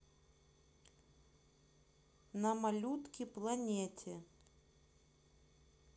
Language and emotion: Russian, neutral